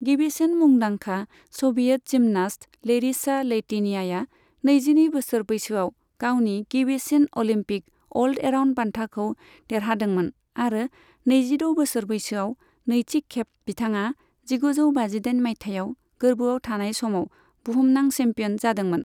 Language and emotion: Bodo, neutral